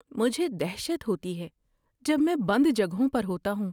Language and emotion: Urdu, fearful